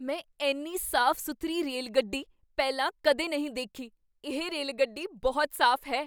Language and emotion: Punjabi, surprised